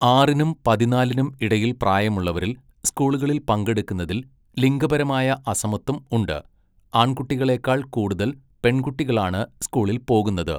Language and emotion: Malayalam, neutral